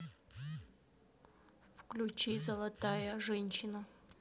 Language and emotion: Russian, neutral